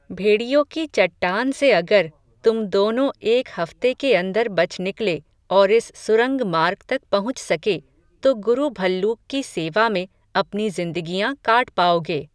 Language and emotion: Hindi, neutral